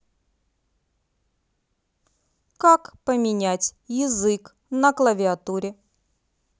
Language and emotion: Russian, neutral